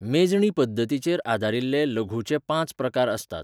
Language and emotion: Goan Konkani, neutral